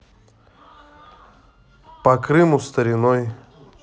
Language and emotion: Russian, neutral